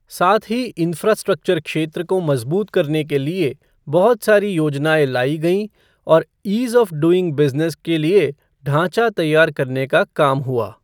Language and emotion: Hindi, neutral